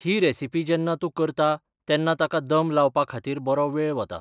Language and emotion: Goan Konkani, neutral